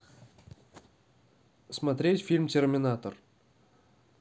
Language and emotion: Russian, neutral